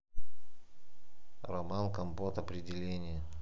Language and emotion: Russian, neutral